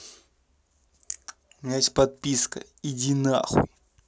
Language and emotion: Russian, angry